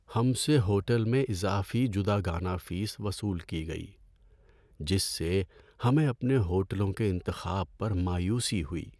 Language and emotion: Urdu, sad